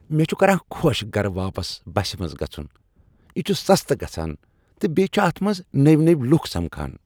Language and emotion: Kashmiri, happy